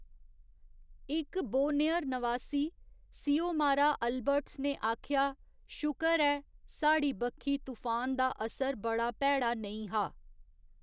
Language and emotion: Dogri, neutral